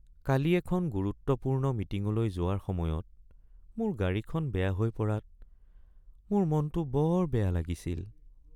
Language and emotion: Assamese, sad